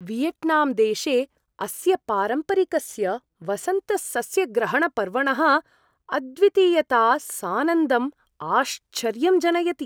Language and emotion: Sanskrit, surprised